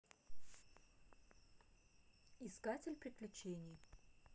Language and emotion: Russian, neutral